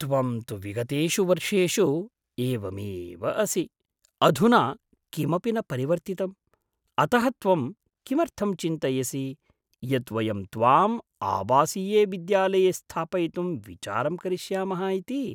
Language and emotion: Sanskrit, surprised